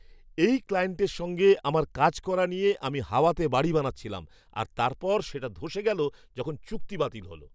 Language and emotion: Bengali, surprised